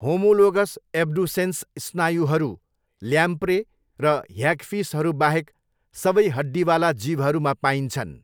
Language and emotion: Nepali, neutral